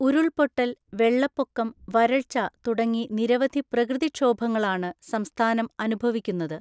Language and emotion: Malayalam, neutral